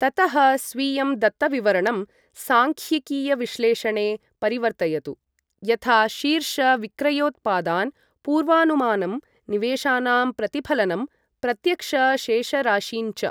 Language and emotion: Sanskrit, neutral